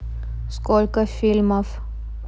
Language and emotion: Russian, neutral